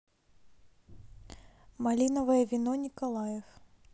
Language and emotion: Russian, neutral